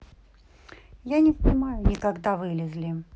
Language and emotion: Russian, neutral